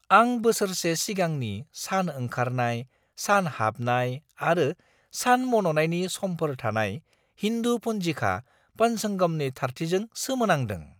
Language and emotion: Bodo, surprised